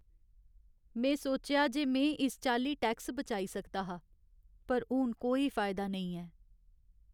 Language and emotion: Dogri, sad